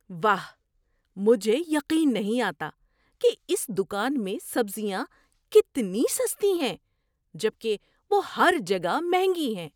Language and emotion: Urdu, surprised